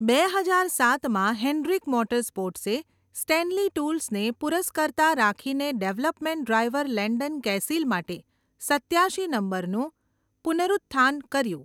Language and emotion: Gujarati, neutral